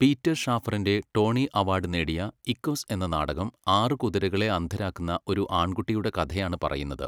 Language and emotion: Malayalam, neutral